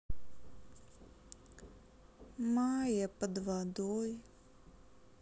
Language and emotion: Russian, sad